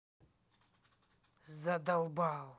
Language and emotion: Russian, angry